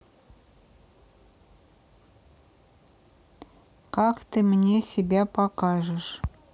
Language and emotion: Russian, neutral